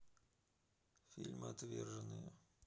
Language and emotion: Russian, neutral